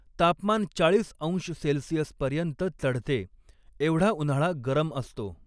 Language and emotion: Marathi, neutral